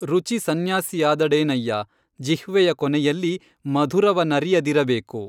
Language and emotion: Kannada, neutral